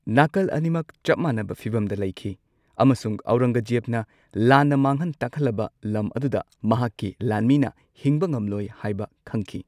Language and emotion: Manipuri, neutral